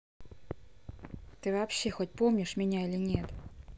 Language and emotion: Russian, angry